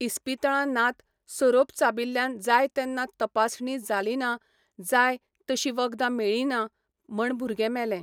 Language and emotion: Goan Konkani, neutral